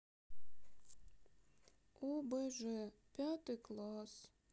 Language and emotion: Russian, sad